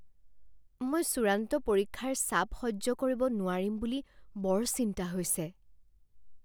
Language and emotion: Assamese, fearful